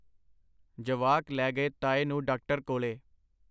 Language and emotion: Punjabi, neutral